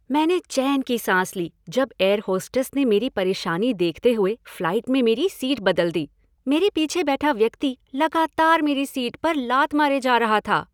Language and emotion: Hindi, happy